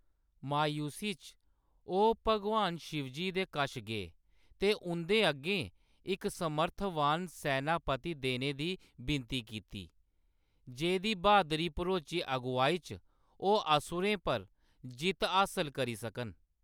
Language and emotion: Dogri, neutral